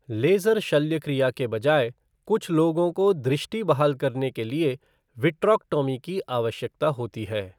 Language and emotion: Hindi, neutral